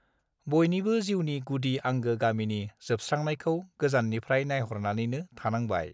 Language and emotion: Bodo, neutral